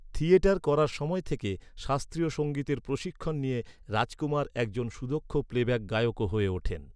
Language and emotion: Bengali, neutral